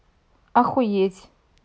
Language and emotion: Russian, neutral